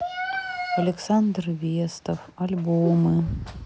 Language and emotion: Russian, sad